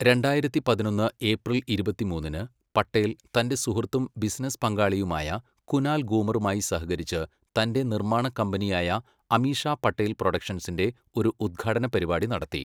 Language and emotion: Malayalam, neutral